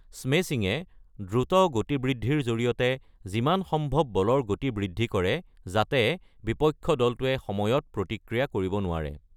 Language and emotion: Assamese, neutral